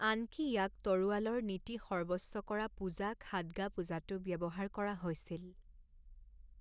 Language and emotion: Assamese, neutral